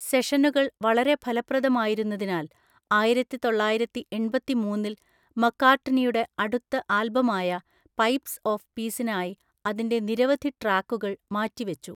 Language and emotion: Malayalam, neutral